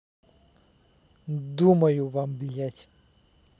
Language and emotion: Russian, angry